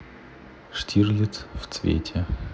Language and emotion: Russian, neutral